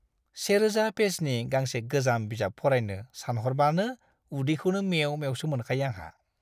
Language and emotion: Bodo, disgusted